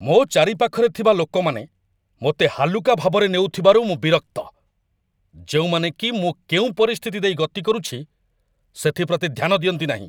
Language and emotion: Odia, angry